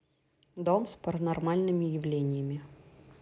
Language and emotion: Russian, neutral